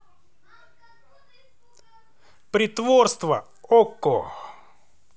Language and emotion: Russian, positive